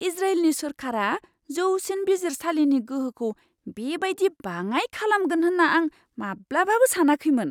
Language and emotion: Bodo, surprised